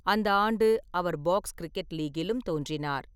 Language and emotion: Tamil, neutral